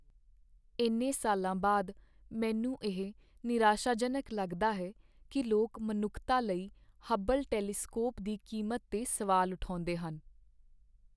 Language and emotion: Punjabi, sad